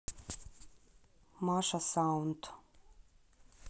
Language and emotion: Russian, neutral